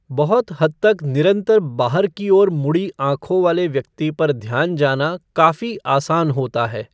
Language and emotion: Hindi, neutral